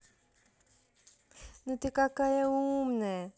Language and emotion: Russian, positive